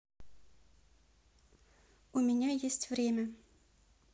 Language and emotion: Russian, neutral